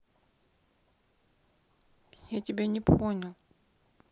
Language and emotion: Russian, sad